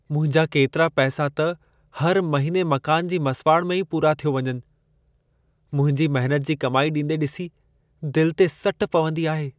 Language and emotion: Sindhi, sad